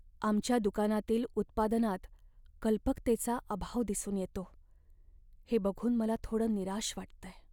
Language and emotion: Marathi, sad